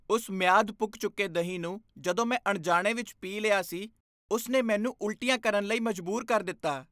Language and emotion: Punjabi, disgusted